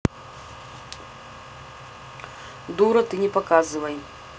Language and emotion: Russian, neutral